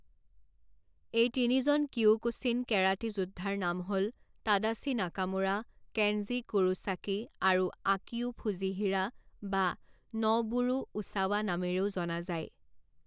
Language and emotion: Assamese, neutral